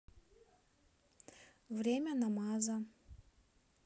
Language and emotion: Russian, neutral